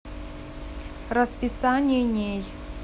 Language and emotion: Russian, neutral